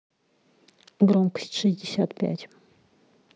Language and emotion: Russian, neutral